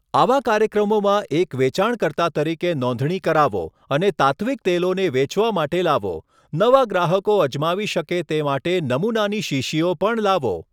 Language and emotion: Gujarati, neutral